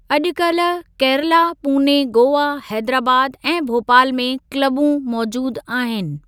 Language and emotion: Sindhi, neutral